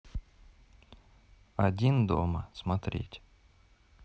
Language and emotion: Russian, neutral